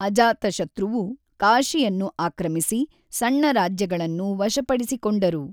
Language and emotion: Kannada, neutral